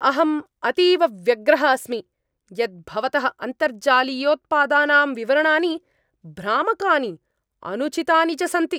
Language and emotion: Sanskrit, angry